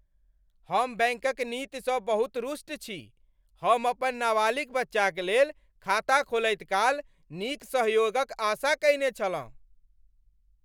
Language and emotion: Maithili, angry